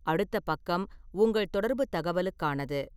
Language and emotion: Tamil, neutral